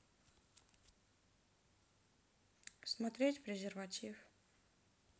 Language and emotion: Russian, neutral